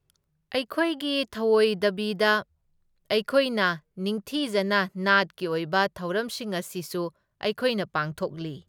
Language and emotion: Manipuri, neutral